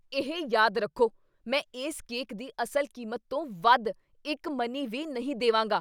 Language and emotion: Punjabi, angry